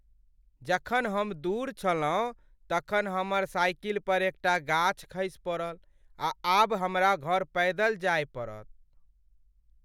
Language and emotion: Maithili, sad